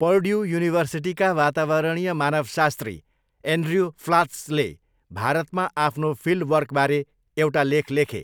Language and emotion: Nepali, neutral